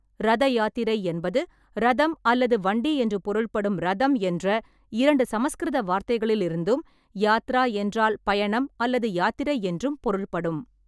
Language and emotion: Tamil, neutral